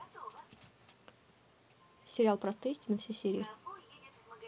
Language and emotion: Russian, neutral